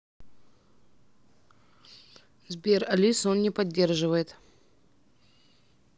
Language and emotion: Russian, neutral